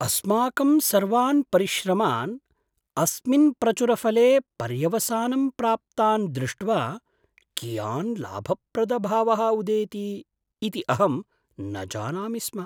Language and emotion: Sanskrit, surprised